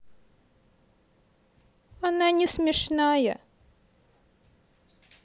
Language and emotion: Russian, sad